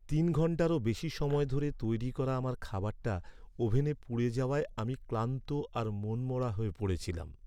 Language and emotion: Bengali, sad